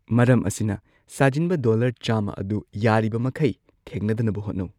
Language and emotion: Manipuri, neutral